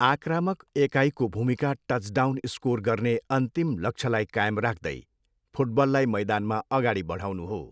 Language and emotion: Nepali, neutral